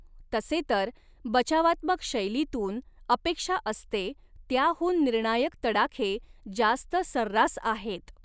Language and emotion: Marathi, neutral